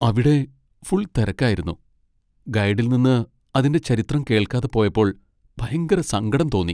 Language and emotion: Malayalam, sad